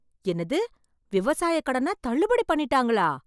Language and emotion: Tamil, surprised